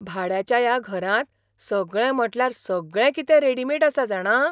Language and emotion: Goan Konkani, surprised